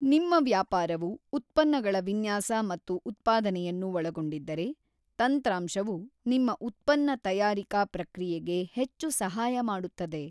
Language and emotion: Kannada, neutral